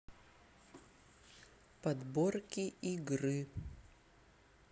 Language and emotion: Russian, neutral